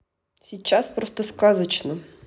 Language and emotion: Russian, neutral